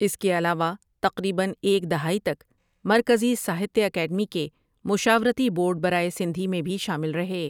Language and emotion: Urdu, neutral